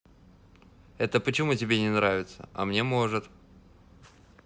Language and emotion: Russian, neutral